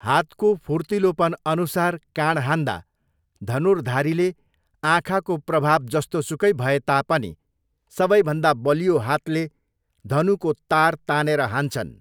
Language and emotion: Nepali, neutral